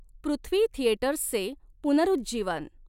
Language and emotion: Marathi, neutral